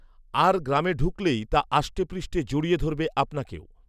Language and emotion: Bengali, neutral